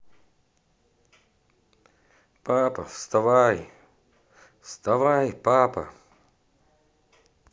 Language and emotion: Russian, positive